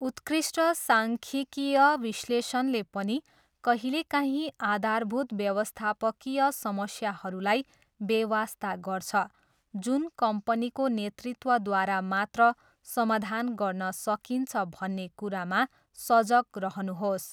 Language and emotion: Nepali, neutral